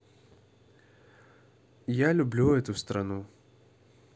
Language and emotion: Russian, neutral